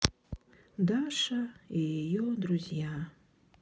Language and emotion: Russian, sad